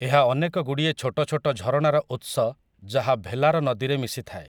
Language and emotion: Odia, neutral